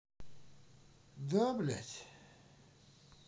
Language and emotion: Russian, sad